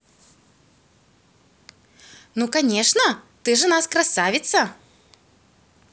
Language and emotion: Russian, positive